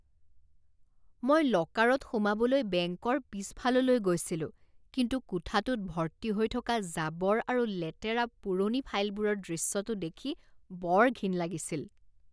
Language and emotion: Assamese, disgusted